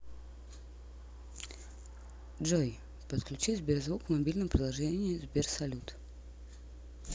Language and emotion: Russian, neutral